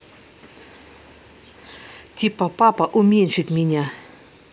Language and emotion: Russian, neutral